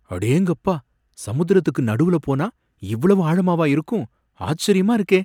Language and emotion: Tamil, surprised